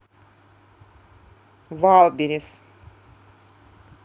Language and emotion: Russian, neutral